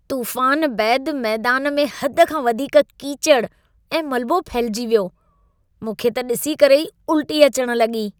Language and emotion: Sindhi, disgusted